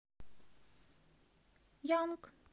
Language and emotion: Russian, neutral